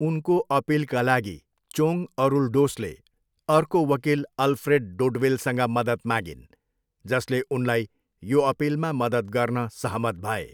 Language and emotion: Nepali, neutral